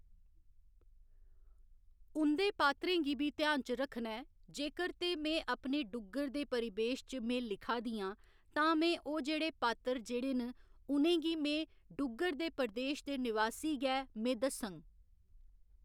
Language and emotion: Dogri, neutral